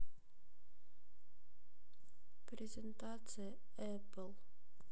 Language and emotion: Russian, neutral